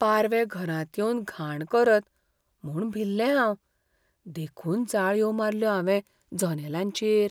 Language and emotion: Goan Konkani, fearful